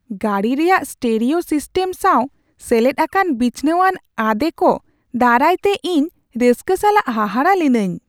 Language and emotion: Santali, surprised